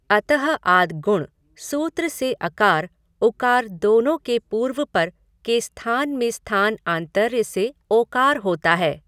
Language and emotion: Hindi, neutral